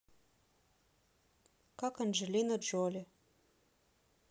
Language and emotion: Russian, neutral